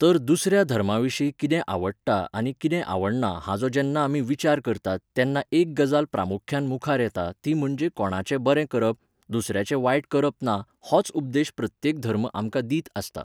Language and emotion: Goan Konkani, neutral